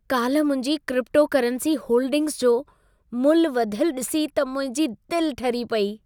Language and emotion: Sindhi, happy